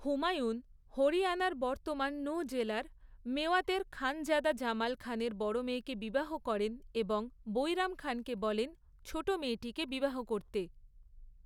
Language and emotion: Bengali, neutral